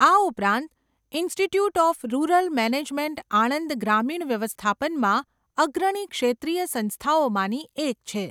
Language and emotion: Gujarati, neutral